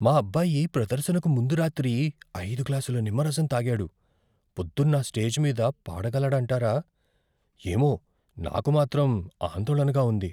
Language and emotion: Telugu, fearful